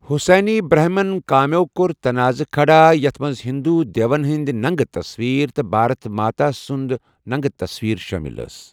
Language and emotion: Kashmiri, neutral